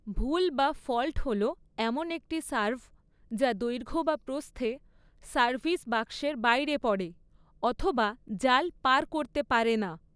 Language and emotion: Bengali, neutral